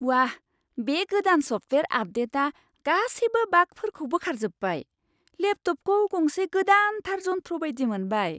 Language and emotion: Bodo, surprised